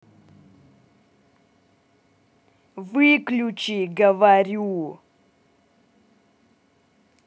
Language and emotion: Russian, angry